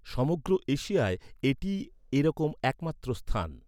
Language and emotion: Bengali, neutral